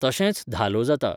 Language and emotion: Goan Konkani, neutral